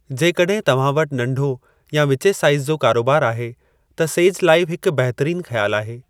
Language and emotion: Sindhi, neutral